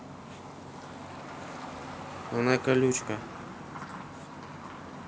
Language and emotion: Russian, neutral